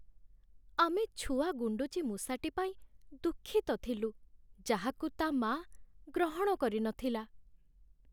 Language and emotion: Odia, sad